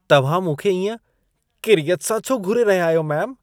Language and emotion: Sindhi, disgusted